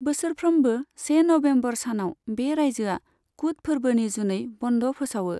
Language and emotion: Bodo, neutral